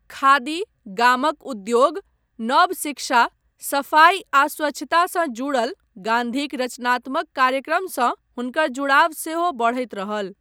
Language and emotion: Maithili, neutral